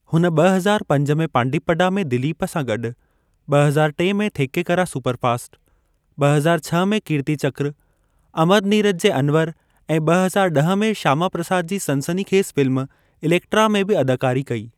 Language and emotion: Sindhi, neutral